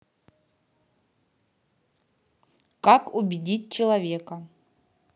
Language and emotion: Russian, neutral